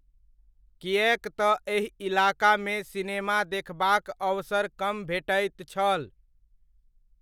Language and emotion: Maithili, neutral